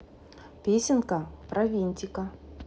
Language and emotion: Russian, positive